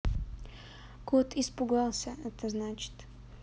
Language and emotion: Russian, neutral